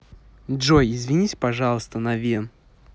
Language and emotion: Russian, angry